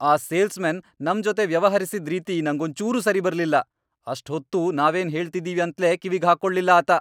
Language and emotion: Kannada, angry